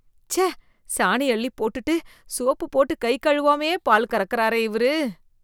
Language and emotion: Tamil, disgusted